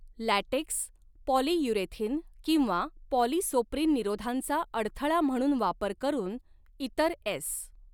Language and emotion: Marathi, neutral